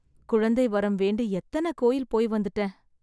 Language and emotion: Tamil, sad